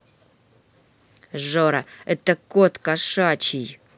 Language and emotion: Russian, angry